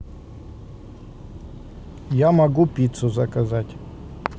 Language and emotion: Russian, neutral